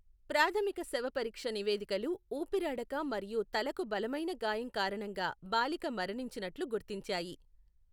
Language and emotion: Telugu, neutral